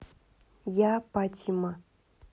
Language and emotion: Russian, neutral